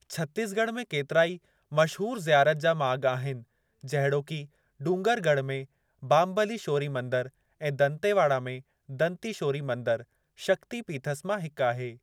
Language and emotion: Sindhi, neutral